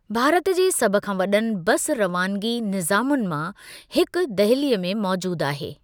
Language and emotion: Sindhi, neutral